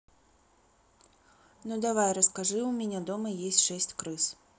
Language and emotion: Russian, neutral